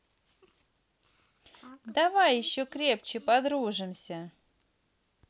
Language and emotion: Russian, positive